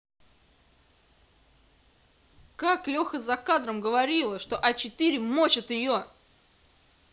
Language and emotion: Russian, angry